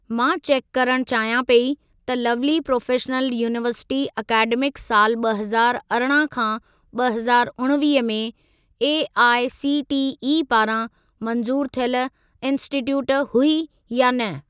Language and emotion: Sindhi, neutral